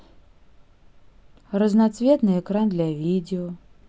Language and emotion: Russian, neutral